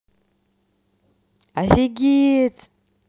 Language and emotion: Russian, positive